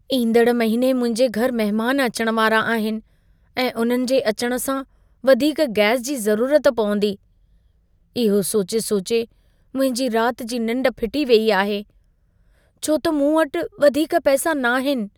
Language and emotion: Sindhi, fearful